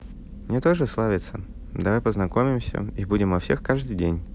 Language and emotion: Russian, neutral